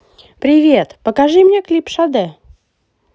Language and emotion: Russian, positive